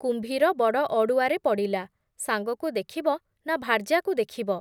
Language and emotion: Odia, neutral